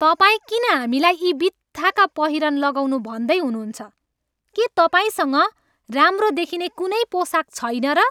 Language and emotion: Nepali, angry